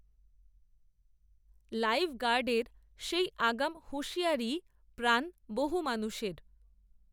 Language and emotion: Bengali, neutral